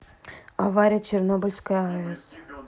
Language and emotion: Russian, neutral